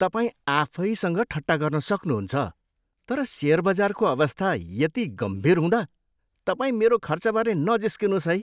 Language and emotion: Nepali, disgusted